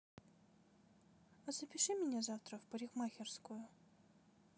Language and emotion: Russian, neutral